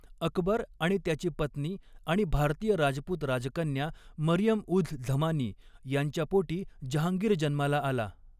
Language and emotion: Marathi, neutral